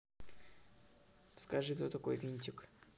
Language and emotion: Russian, neutral